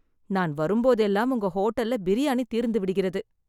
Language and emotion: Tamil, sad